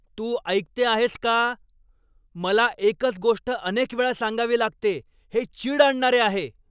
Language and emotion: Marathi, angry